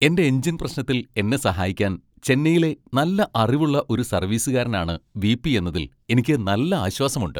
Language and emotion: Malayalam, happy